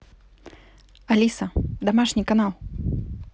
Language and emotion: Russian, neutral